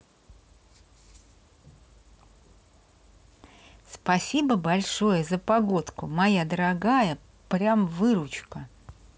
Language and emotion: Russian, positive